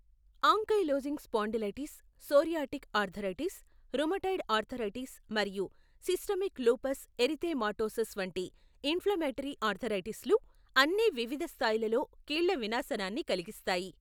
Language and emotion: Telugu, neutral